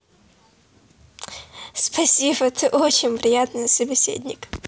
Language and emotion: Russian, positive